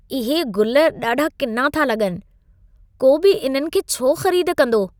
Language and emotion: Sindhi, disgusted